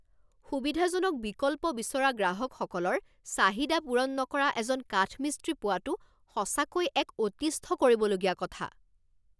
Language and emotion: Assamese, angry